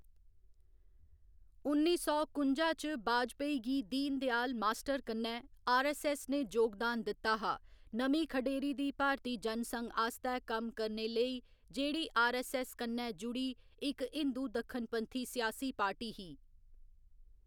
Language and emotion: Dogri, neutral